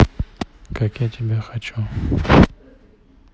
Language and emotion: Russian, neutral